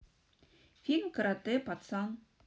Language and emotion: Russian, neutral